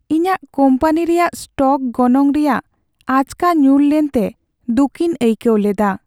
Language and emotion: Santali, sad